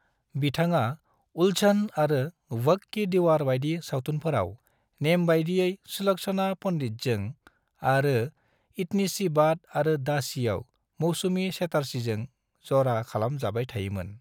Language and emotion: Bodo, neutral